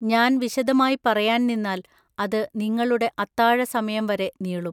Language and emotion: Malayalam, neutral